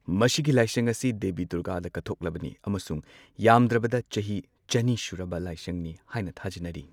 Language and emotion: Manipuri, neutral